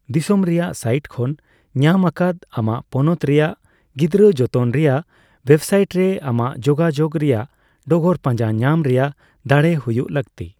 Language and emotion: Santali, neutral